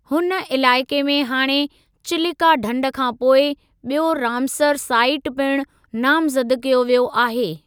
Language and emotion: Sindhi, neutral